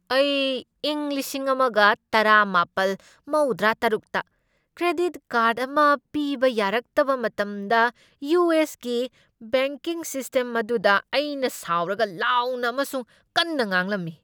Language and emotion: Manipuri, angry